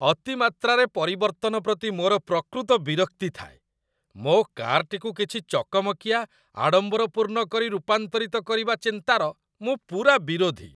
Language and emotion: Odia, disgusted